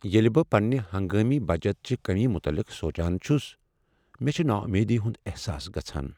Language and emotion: Kashmiri, sad